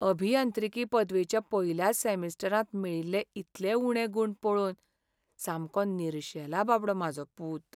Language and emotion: Goan Konkani, sad